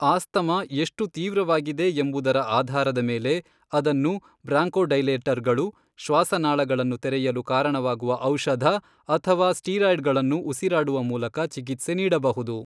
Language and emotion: Kannada, neutral